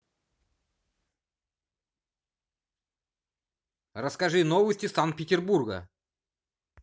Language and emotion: Russian, positive